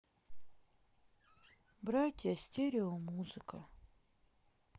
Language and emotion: Russian, sad